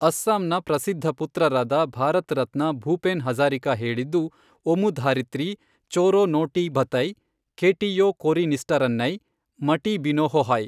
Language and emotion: Kannada, neutral